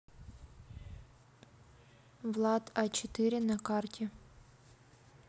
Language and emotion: Russian, neutral